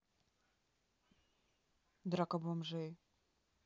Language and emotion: Russian, neutral